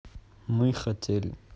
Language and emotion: Russian, neutral